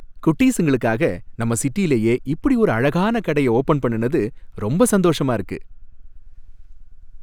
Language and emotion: Tamil, happy